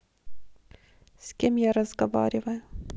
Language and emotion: Russian, sad